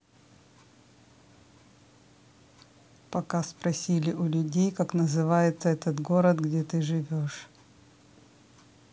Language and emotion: Russian, neutral